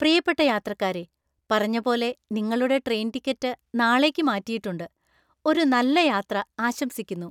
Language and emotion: Malayalam, happy